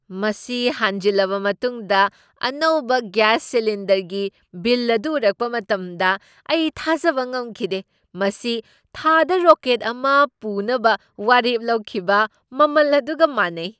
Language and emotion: Manipuri, surprised